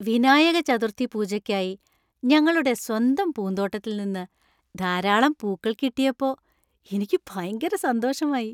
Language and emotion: Malayalam, happy